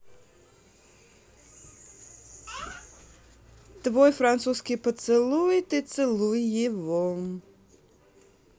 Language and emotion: Russian, neutral